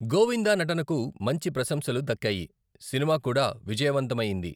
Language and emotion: Telugu, neutral